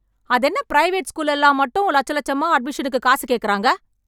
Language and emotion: Tamil, angry